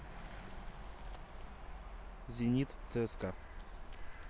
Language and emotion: Russian, neutral